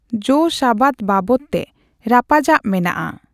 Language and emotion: Santali, neutral